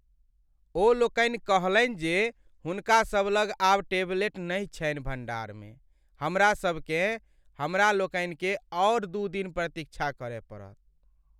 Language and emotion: Maithili, sad